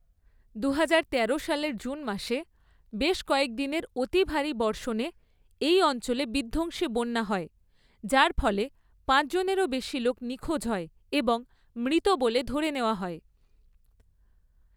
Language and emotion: Bengali, neutral